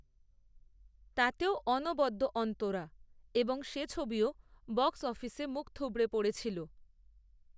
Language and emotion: Bengali, neutral